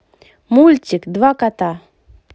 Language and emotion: Russian, positive